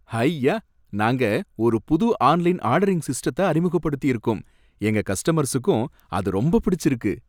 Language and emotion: Tamil, happy